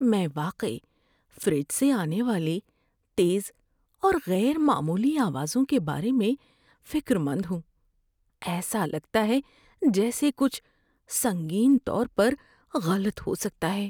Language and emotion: Urdu, fearful